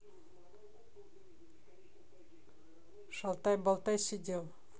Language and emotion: Russian, neutral